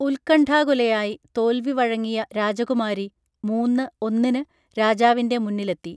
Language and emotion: Malayalam, neutral